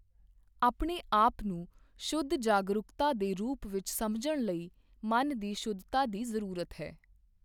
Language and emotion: Punjabi, neutral